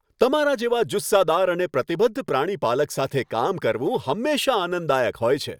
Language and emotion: Gujarati, happy